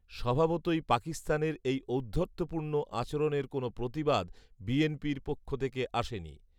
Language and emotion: Bengali, neutral